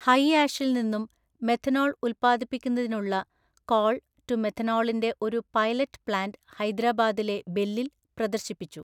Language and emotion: Malayalam, neutral